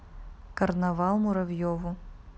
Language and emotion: Russian, neutral